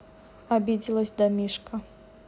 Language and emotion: Russian, neutral